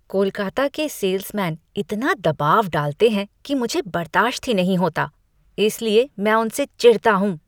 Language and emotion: Hindi, disgusted